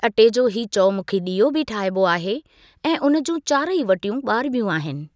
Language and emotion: Sindhi, neutral